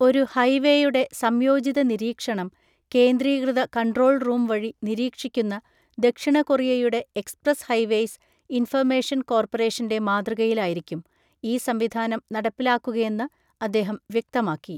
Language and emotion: Malayalam, neutral